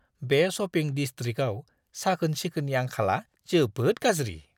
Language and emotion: Bodo, disgusted